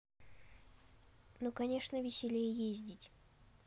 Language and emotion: Russian, neutral